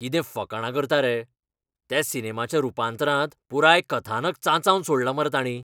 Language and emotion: Goan Konkani, angry